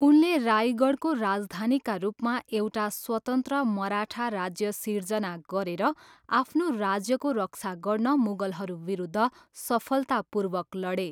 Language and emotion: Nepali, neutral